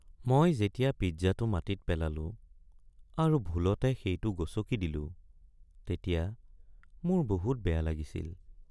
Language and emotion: Assamese, sad